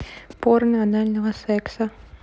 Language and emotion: Russian, neutral